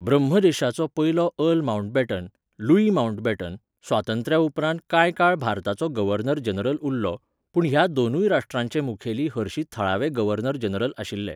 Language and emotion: Goan Konkani, neutral